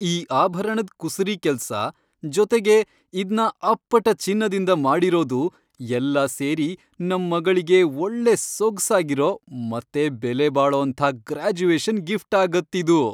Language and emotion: Kannada, happy